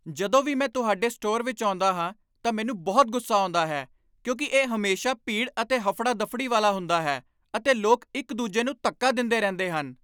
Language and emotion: Punjabi, angry